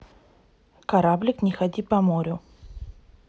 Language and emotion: Russian, neutral